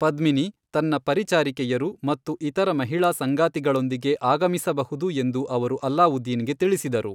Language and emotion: Kannada, neutral